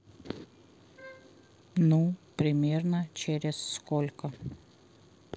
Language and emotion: Russian, neutral